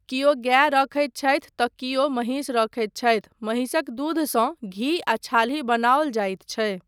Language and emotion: Maithili, neutral